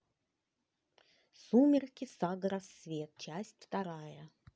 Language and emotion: Russian, neutral